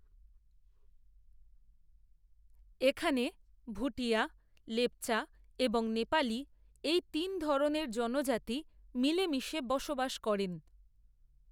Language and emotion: Bengali, neutral